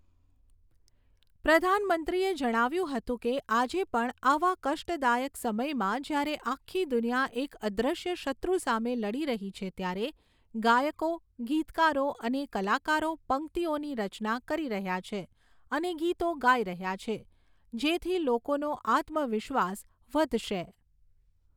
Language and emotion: Gujarati, neutral